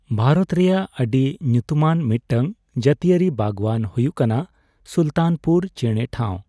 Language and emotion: Santali, neutral